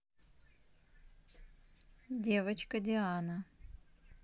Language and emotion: Russian, neutral